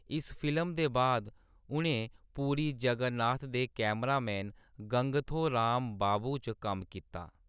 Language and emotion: Dogri, neutral